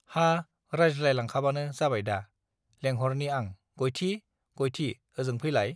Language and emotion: Bodo, neutral